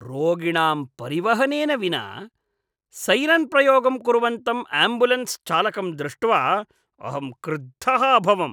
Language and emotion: Sanskrit, disgusted